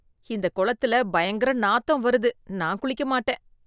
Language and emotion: Tamil, disgusted